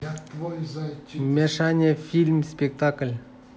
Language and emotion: Russian, neutral